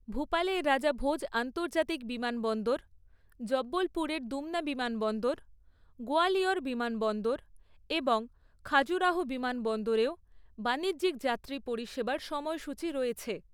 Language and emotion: Bengali, neutral